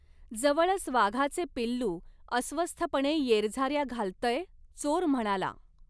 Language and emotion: Marathi, neutral